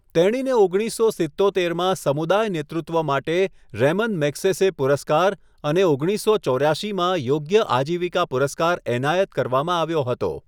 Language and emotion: Gujarati, neutral